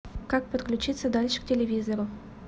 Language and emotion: Russian, neutral